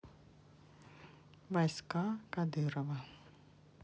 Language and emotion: Russian, neutral